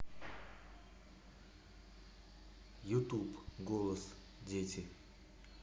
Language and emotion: Russian, neutral